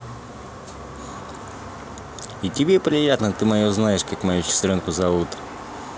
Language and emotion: Russian, positive